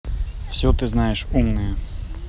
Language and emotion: Russian, neutral